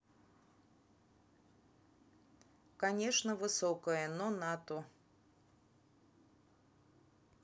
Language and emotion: Russian, neutral